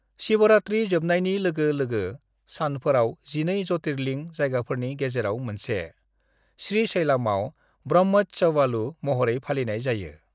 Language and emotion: Bodo, neutral